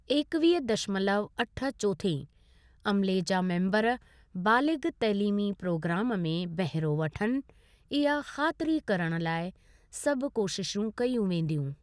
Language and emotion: Sindhi, neutral